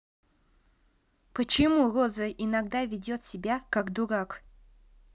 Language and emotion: Russian, neutral